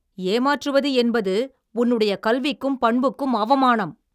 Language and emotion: Tamil, angry